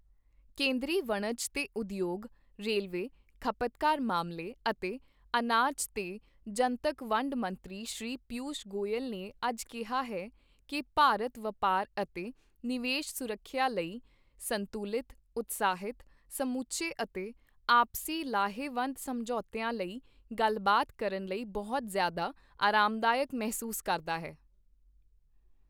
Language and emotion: Punjabi, neutral